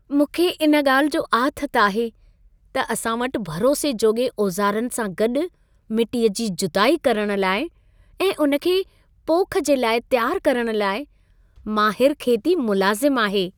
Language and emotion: Sindhi, happy